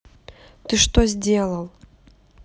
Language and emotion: Russian, neutral